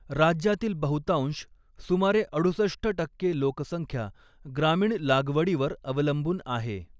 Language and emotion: Marathi, neutral